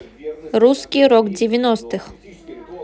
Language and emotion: Russian, neutral